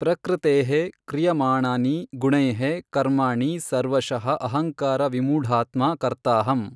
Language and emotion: Kannada, neutral